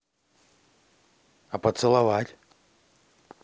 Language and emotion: Russian, positive